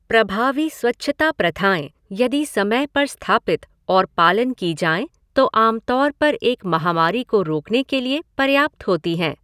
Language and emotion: Hindi, neutral